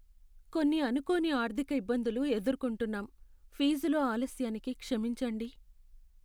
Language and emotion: Telugu, sad